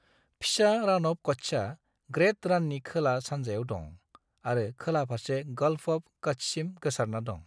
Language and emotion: Bodo, neutral